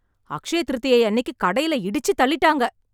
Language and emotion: Tamil, angry